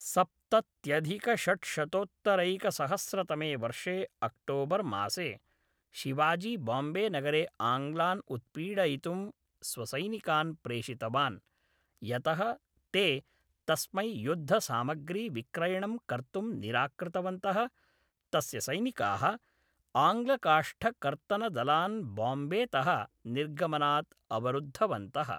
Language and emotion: Sanskrit, neutral